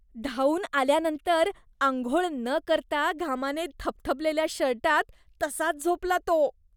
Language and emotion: Marathi, disgusted